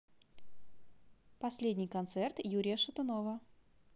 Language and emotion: Russian, positive